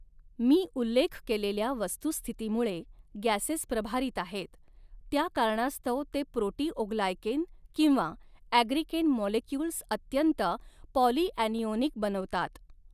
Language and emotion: Marathi, neutral